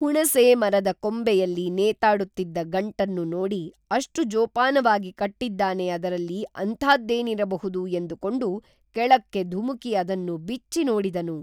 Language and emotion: Kannada, neutral